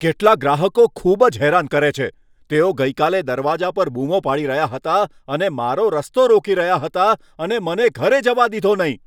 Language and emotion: Gujarati, angry